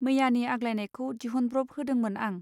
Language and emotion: Bodo, neutral